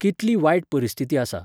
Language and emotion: Goan Konkani, neutral